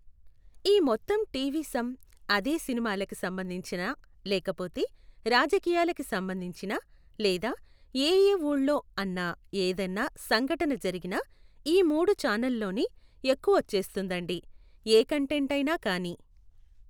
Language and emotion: Telugu, neutral